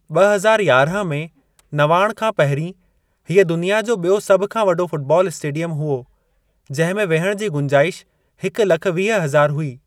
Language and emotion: Sindhi, neutral